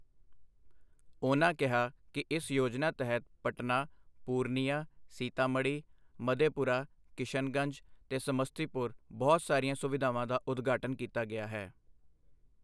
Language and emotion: Punjabi, neutral